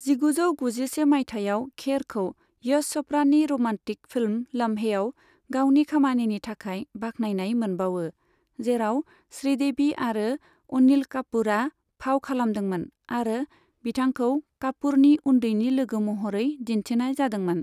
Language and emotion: Bodo, neutral